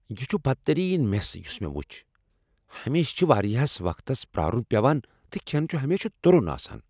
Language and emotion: Kashmiri, angry